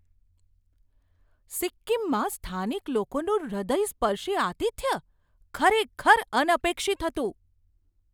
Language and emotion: Gujarati, surprised